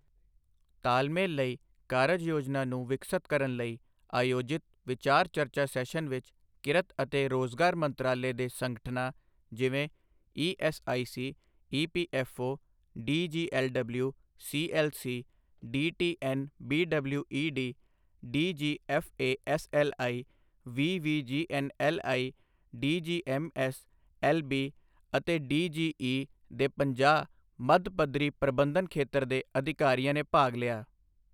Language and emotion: Punjabi, neutral